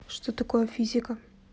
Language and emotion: Russian, neutral